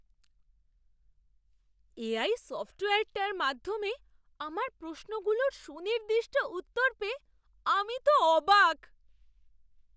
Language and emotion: Bengali, surprised